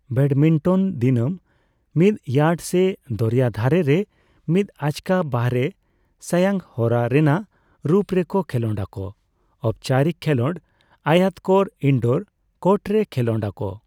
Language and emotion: Santali, neutral